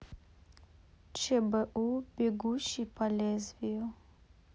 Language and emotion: Russian, neutral